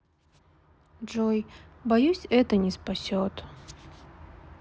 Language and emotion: Russian, sad